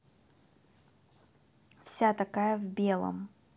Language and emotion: Russian, neutral